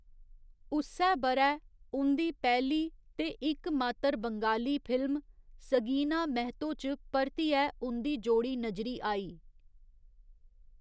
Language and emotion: Dogri, neutral